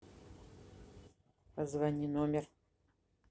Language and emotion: Russian, neutral